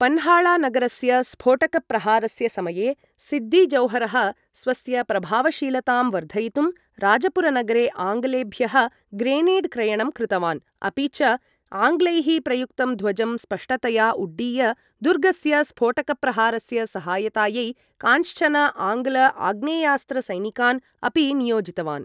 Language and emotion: Sanskrit, neutral